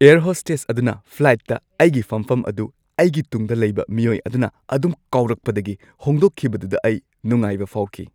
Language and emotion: Manipuri, happy